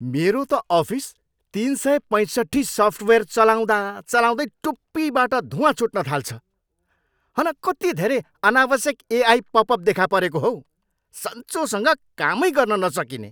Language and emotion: Nepali, angry